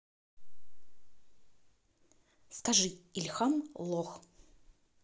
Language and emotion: Russian, angry